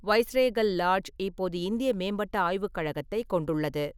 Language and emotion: Tamil, neutral